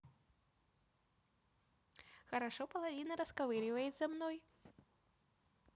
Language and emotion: Russian, positive